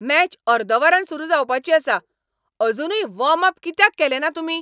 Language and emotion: Goan Konkani, angry